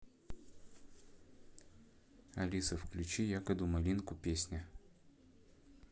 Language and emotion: Russian, neutral